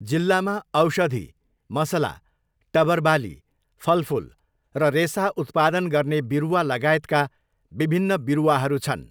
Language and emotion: Nepali, neutral